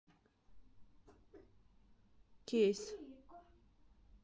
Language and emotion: Russian, neutral